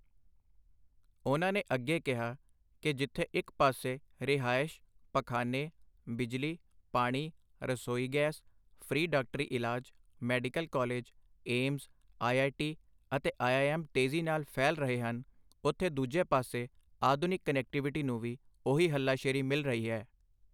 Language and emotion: Punjabi, neutral